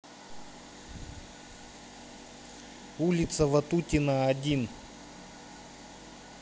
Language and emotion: Russian, neutral